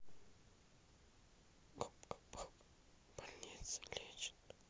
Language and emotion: Russian, neutral